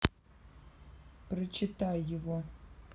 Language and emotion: Russian, neutral